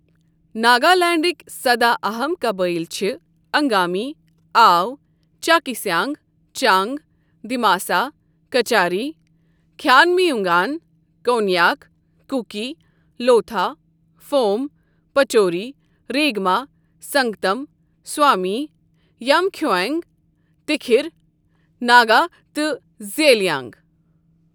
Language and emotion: Kashmiri, neutral